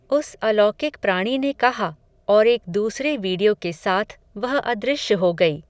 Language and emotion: Hindi, neutral